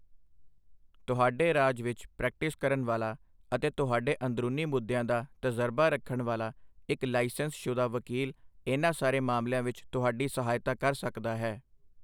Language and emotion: Punjabi, neutral